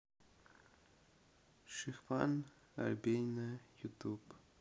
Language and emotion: Russian, sad